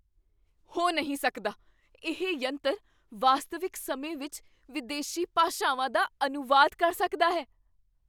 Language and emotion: Punjabi, surprised